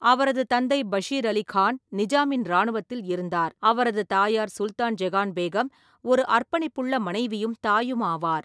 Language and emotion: Tamil, neutral